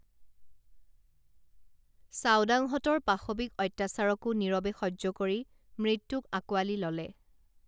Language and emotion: Assamese, neutral